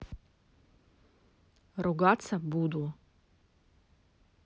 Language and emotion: Russian, neutral